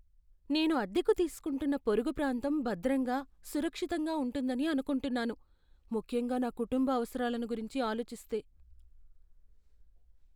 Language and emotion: Telugu, fearful